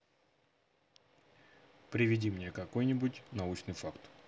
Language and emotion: Russian, neutral